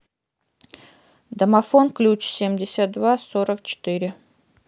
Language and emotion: Russian, neutral